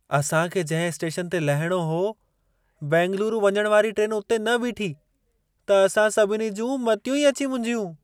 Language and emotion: Sindhi, surprised